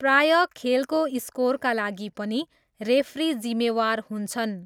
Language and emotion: Nepali, neutral